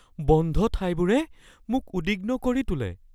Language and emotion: Assamese, fearful